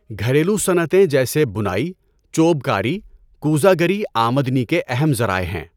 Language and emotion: Urdu, neutral